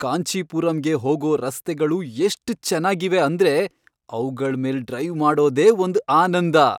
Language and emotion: Kannada, happy